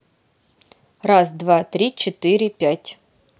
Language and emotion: Russian, neutral